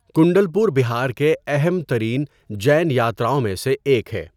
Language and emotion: Urdu, neutral